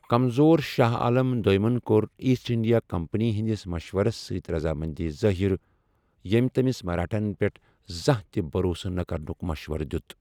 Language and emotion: Kashmiri, neutral